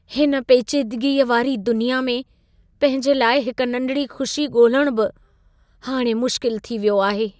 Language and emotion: Sindhi, sad